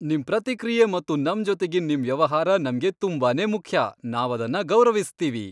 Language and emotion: Kannada, happy